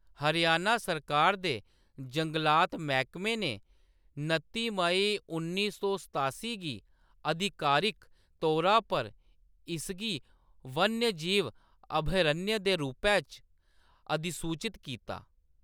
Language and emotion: Dogri, neutral